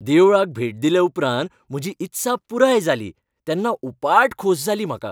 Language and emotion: Goan Konkani, happy